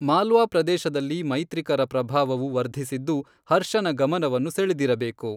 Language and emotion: Kannada, neutral